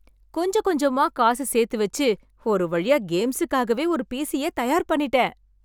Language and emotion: Tamil, happy